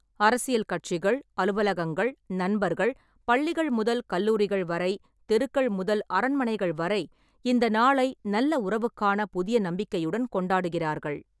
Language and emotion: Tamil, neutral